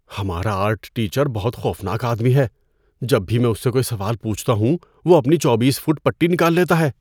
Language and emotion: Urdu, fearful